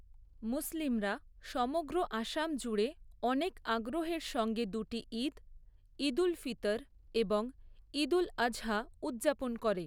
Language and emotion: Bengali, neutral